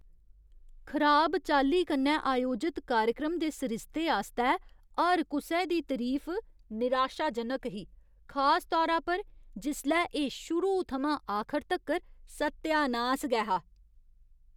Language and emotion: Dogri, disgusted